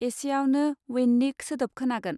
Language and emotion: Bodo, neutral